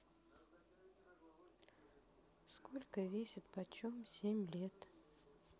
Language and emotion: Russian, neutral